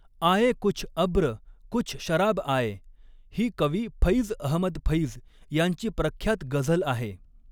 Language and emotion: Marathi, neutral